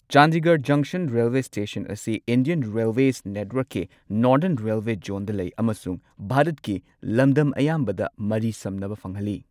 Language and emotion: Manipuri, neutral